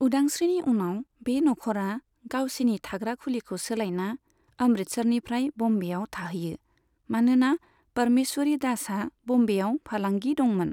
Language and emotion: Bodo, neutral